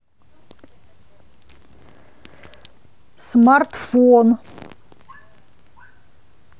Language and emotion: Russian, neutral